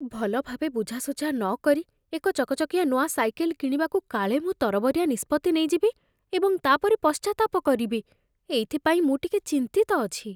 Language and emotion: Odia, fearful